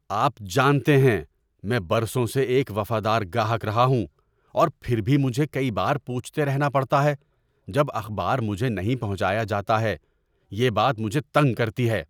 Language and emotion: Urdu, angry